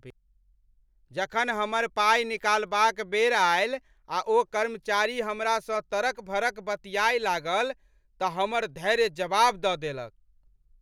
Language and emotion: Maithili, angry